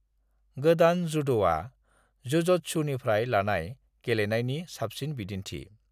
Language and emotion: Bodo, neutral